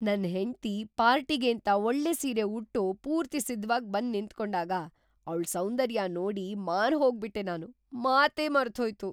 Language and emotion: Kannada, surprised